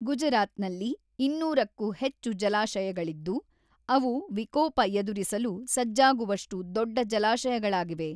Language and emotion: Kannada, neutral